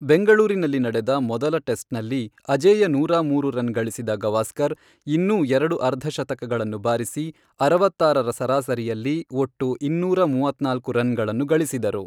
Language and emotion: Kannada, neutral